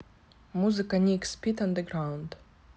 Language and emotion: Russian, neutral